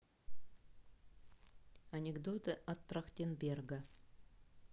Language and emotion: Russian, neutral